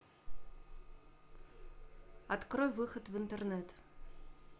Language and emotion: Russian, neutral